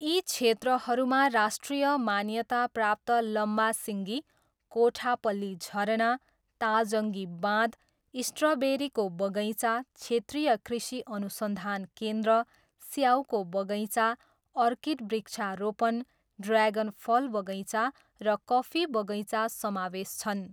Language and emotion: Nepali, neutral